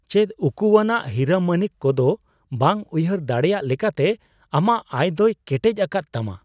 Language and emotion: Santali, surprised